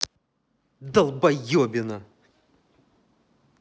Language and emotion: Russian, angry